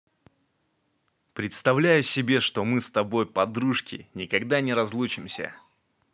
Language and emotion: Russian, positive